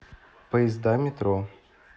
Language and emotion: Russian, neutral